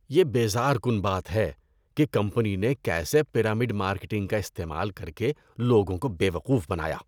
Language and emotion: Urdu, disgusted